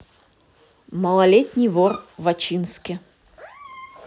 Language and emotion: Russian, neutral